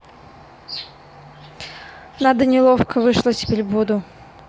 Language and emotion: Russian, neutral